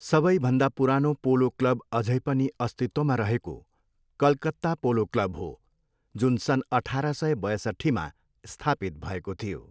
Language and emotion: Nepali, neutral